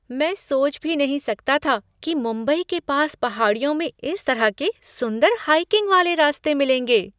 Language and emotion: Hindi, surprised